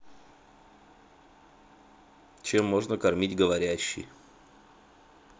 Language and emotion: Russian, neutral